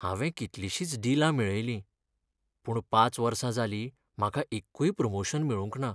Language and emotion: Goan Konkani, sad